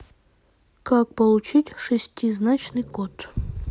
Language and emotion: Russian, neutral